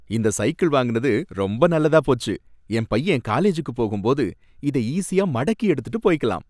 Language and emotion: Tamil, happy